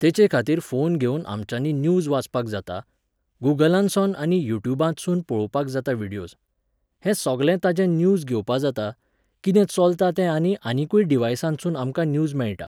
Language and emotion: Goan Konkani, neutral